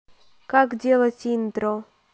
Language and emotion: Russian, neutral